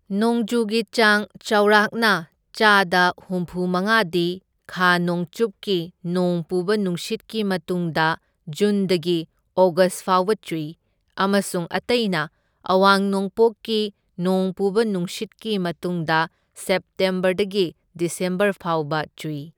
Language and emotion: Manipuri, neutral